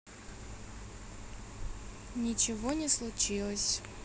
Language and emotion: Russian, neutral